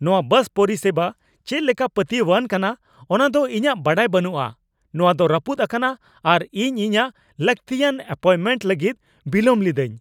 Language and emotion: Santali, angry